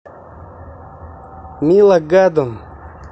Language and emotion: Russian, neutral